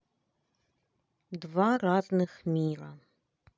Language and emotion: Russian, neutral